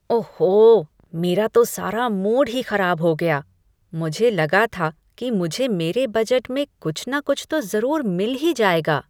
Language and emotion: Hindi, disgusted